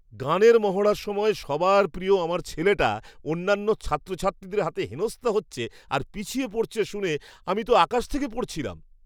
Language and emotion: Bengali, surprised